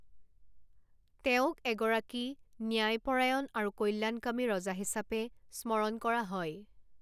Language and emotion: Assamese, neutral